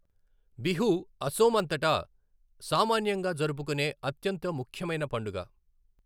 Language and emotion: Telugu, neutral